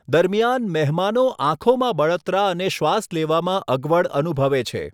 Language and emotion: Gujarati, neutral